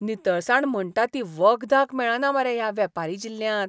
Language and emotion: Goan Konkani, disgusted